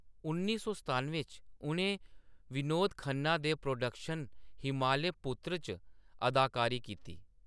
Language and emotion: Dogri, neutral